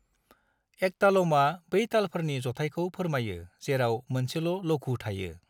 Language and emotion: Bodo, neutral